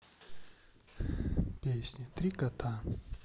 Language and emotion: Russian, neutral